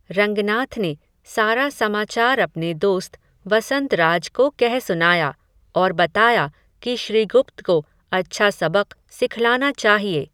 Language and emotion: Hindi, neutral